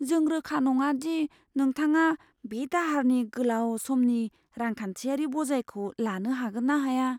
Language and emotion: Bodo, fearful